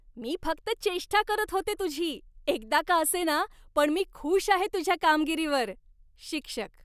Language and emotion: Marathi, happy